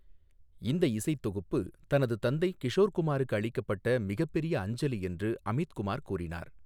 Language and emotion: Tamil, neutral